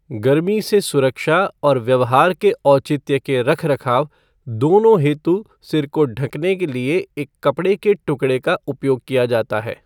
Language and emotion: Hindi, neutral